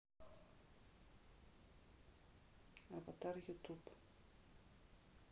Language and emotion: Russian, neutral